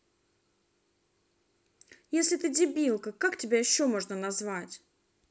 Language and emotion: Russian, angry